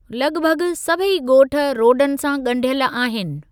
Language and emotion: Sindhi, neutral